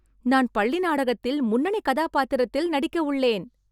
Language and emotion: Tamil, happy